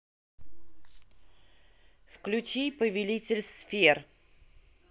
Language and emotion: Russian, neutral